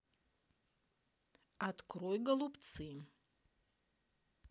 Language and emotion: Russian, neutral